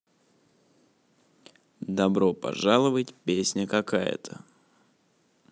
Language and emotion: Russian, neutral